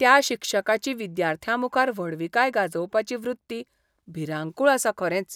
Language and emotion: Goan Konkani, disgusted